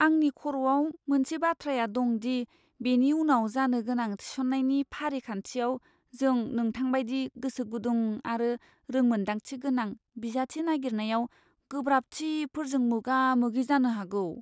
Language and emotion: Bodo, fearful